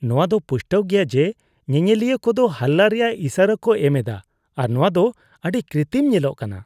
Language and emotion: Santali, disgusted